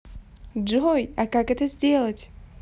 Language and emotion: Russian, positive